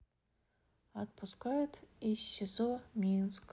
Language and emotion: Russian, sad